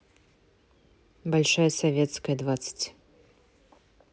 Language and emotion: Russian, neutral